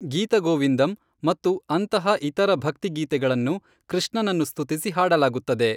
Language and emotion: Kannada, neutral